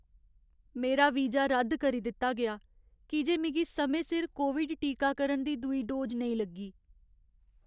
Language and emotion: Dogri, sad